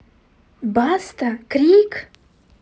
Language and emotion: Russian, angry